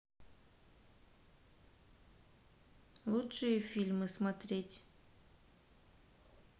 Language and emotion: Russian, neutral